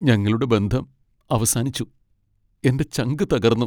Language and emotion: Malayalam, sad